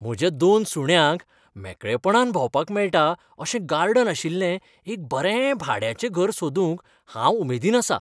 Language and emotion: Goan Konkani, happy